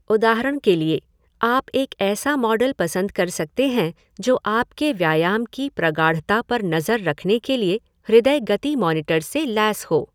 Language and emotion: Hindi, neutral